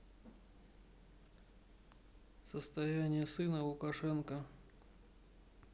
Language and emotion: Russian, neutral